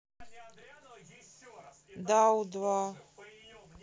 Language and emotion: Russian, neutral